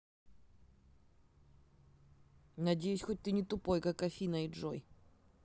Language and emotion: Russian, neutral